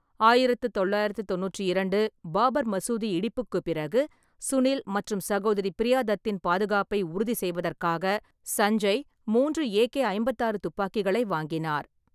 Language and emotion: Tamil, neutral